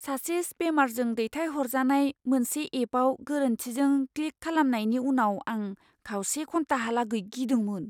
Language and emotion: Bodo, fearful